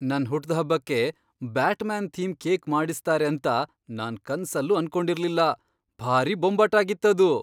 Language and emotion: Kannada, surprised